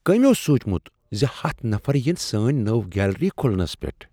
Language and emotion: Kashmiri, surprised